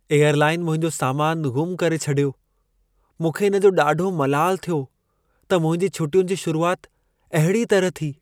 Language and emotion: Sindhi, sad